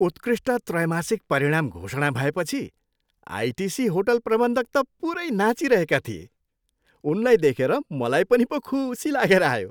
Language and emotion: Nepali, happy